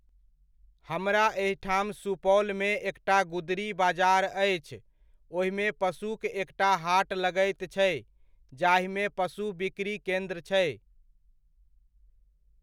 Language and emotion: Maithili, neutral